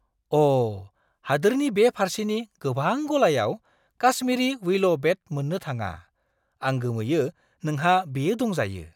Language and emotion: Bodo, surprised